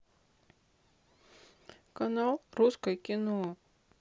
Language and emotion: Russian, sad